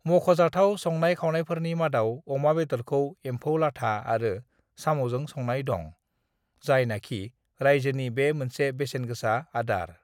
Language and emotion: Bodo, neutral